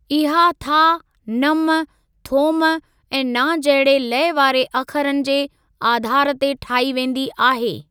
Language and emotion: Sindhi, neutral